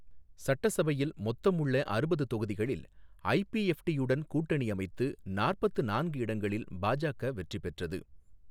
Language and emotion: Tamil, neutral